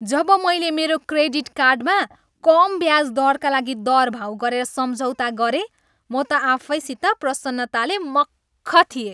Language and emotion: Nepali, happy